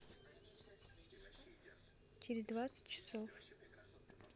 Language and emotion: Russian, neutral